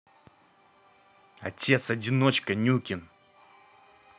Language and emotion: Russian, angry